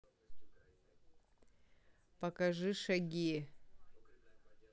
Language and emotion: Russian, neutral